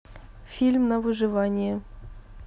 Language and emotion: Russian, neutral